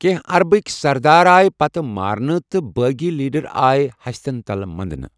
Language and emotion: Kashmiri, neutral